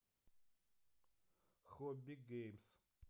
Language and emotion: Russian, neutral